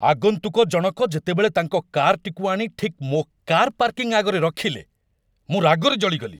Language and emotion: Odia, angry